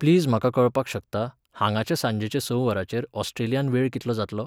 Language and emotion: Goan Konkani, neutral